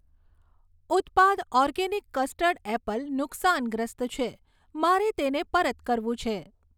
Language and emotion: Gujarati, neutral